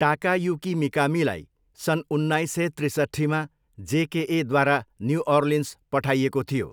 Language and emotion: Nepali, neutral